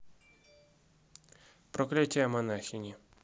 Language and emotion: Russian, neutral